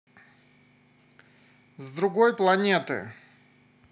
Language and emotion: Russian, positive